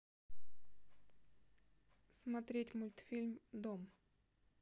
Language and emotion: Russian, neutral